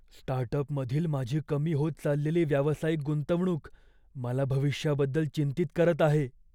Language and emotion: Marathi, fearful